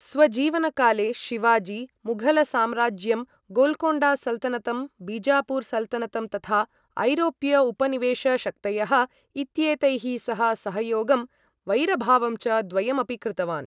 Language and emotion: Sanskrit, neutral